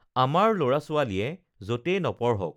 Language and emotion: Assamese, neutral